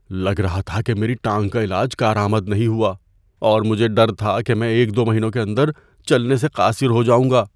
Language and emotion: Urdu, fearful